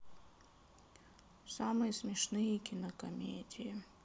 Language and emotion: Russian, sad